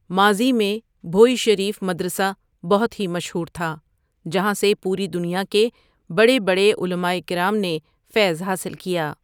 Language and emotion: Urdu, neutral